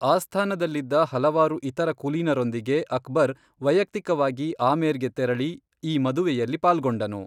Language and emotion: Kannada, neutral